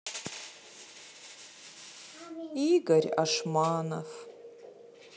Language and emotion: Russian, sad